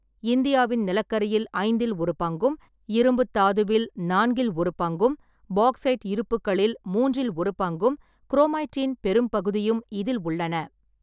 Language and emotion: Tamil, neutral